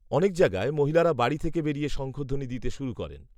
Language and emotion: Bengali, neutral